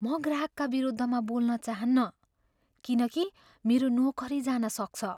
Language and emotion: Nepali, fearful